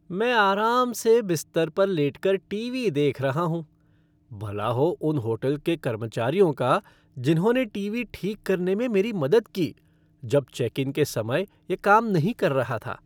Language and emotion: Hindi, happy